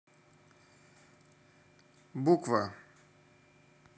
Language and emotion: Russian, neutral